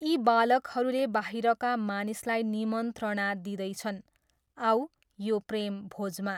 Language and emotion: Nepali, neutral